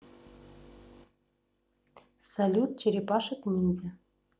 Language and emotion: Russian, neutral